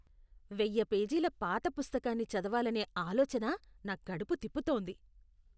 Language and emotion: Telugu, disgusted